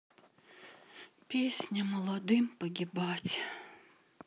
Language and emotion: Russian, sad